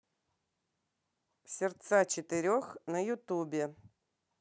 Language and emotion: Russian, neutral